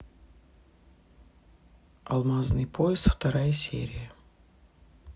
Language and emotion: Russian, neutral